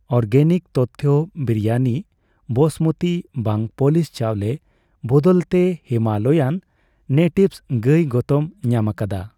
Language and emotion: Santali, neutral